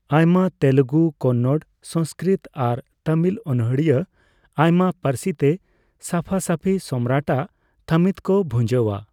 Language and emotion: Santali, neutral